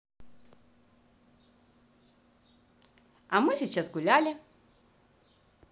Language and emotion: Russian, positive